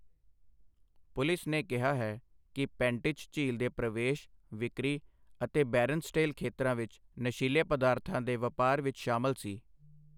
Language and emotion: Punjabi, neutral